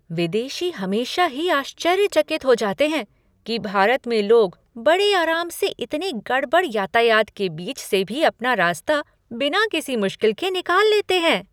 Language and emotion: Hindi, surprised